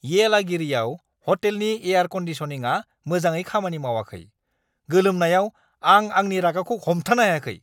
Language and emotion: Bodo, angry